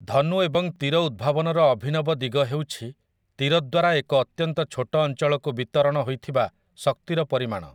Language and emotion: Odia, neutral